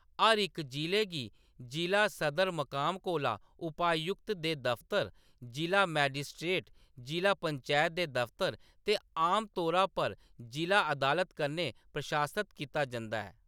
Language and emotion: Dogri, neutral